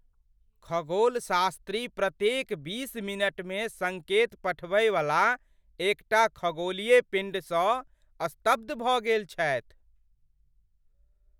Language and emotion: Maithili, surprised